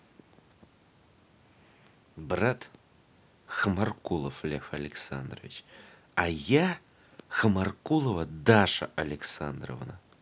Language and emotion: Russian, angry